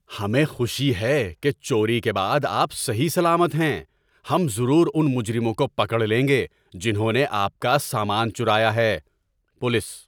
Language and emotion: Urdu, happy